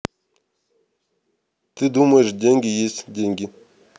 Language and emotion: Russian, neutral